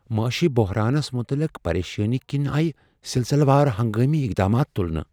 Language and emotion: Kashmiri, fearful